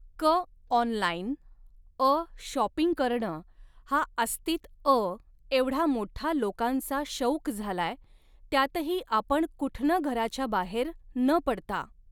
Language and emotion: Marathi, neutral